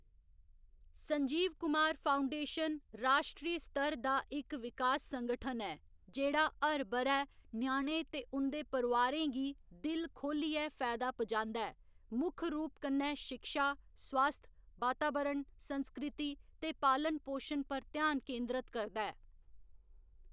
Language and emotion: Dogri, neutral